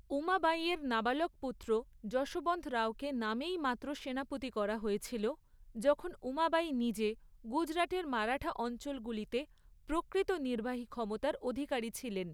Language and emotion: Bengali, neutral